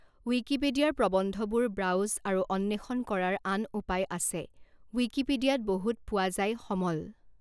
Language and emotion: Assamese, neutral